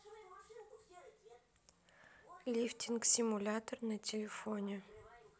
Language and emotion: Russian, neutral